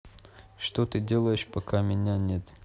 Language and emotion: Russian, neutral